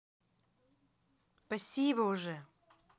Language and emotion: Russian, positive